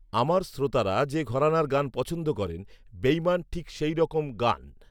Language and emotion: Bengali, neutral